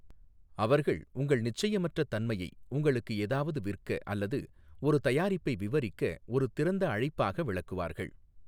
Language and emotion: Tamil, neutral